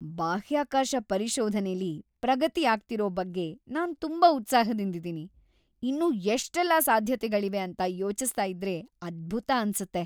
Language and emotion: Kannada, happy